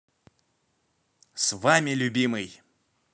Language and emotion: Russian, positive